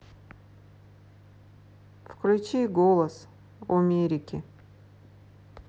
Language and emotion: Russian, neutral